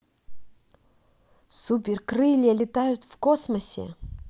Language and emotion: Russian, positive